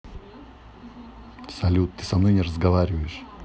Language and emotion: Russian, neutral